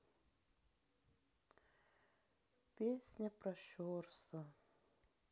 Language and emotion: Russian, sad